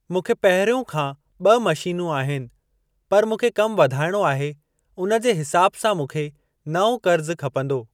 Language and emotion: Sindhi, neutral